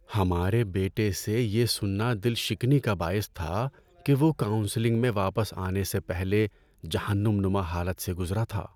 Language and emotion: Urdu, sad